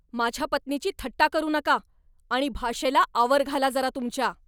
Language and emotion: Marathi, angry